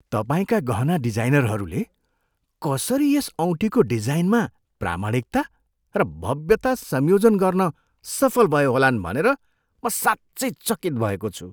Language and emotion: Nepali, surprised